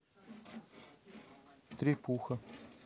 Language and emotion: Russian, neutral